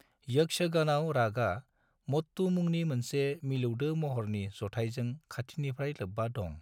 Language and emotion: Bodo, neutral